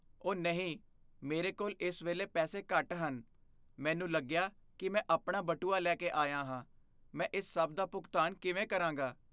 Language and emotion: Punjabi, fearful